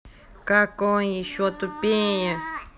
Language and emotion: Russian, angry